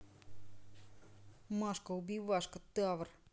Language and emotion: Russian, angry